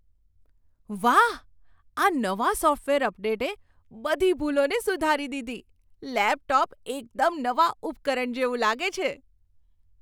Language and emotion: Gujarati, surprised